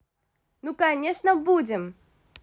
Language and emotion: Russian, positive